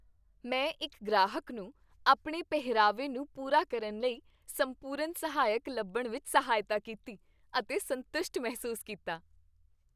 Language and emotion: Punjabi, happy